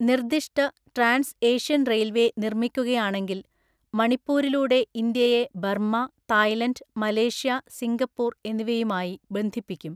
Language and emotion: Malayalam, neutral